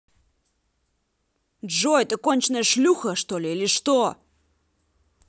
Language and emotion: Russian, angry